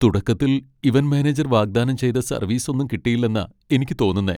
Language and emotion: Malayalam, sad